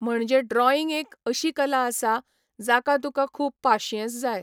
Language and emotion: Goan Konkani, neutral